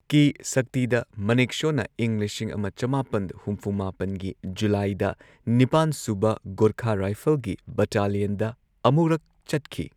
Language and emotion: Manipuri, neutral